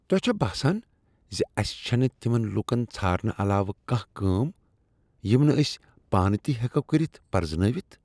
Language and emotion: Kashmiri, disgusted